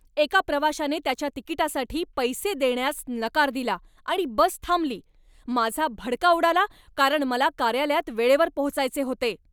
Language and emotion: Marathi, angry